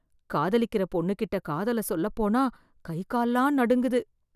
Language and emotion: Tamil, fearful